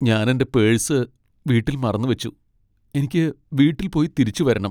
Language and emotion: Malayalam, sad